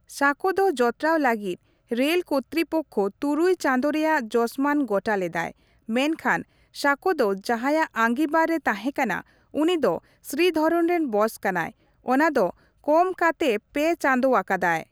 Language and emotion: Santali, neutral